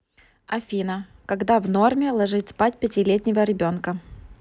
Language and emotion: Russian, neutral